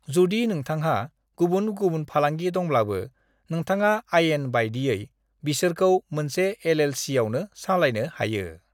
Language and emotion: Bodo, neutral